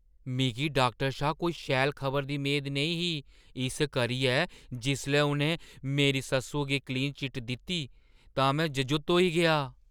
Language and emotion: Dogri, surprised